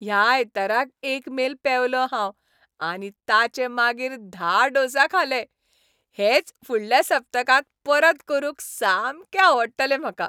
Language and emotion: Goan Konkani, happy